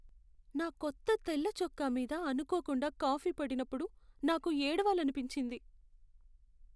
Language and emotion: Telugu, sad